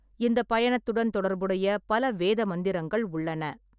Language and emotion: Tamil, neutral